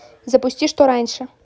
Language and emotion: Russian, neutral